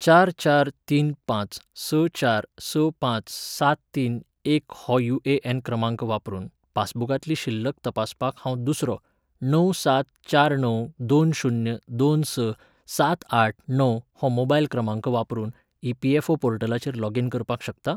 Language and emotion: Goan Konkani, neutral